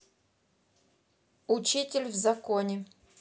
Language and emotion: Russian, neutral